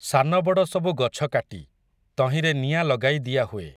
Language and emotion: Odia, neutral